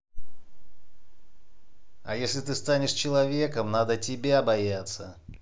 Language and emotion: Russian, angry